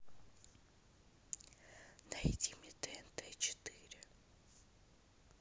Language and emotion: Russian, neutral